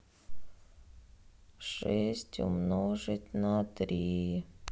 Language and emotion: Russian, sad